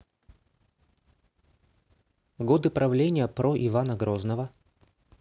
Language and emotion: Russian, neutral